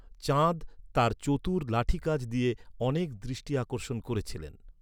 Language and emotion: Bengali, neutral